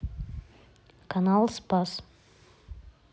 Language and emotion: Russian, neutral